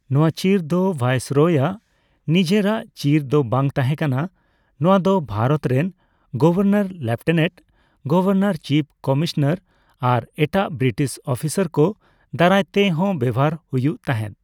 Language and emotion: Santali, neutral